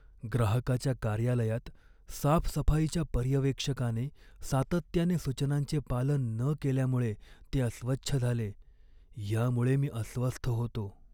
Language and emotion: Marathi, sad